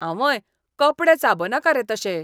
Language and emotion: Goan Konkani, disgusted